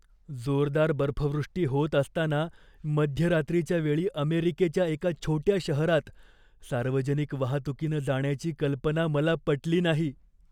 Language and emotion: Marathi, fearful